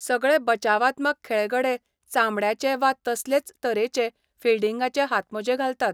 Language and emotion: Goan Konkani, neutral